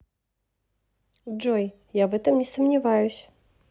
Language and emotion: Russian, neutral